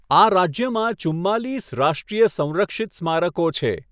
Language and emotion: Gujarati, neutral